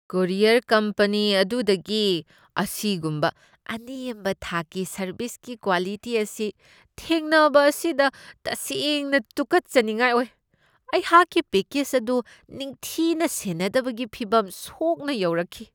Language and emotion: Manipuri, disgusted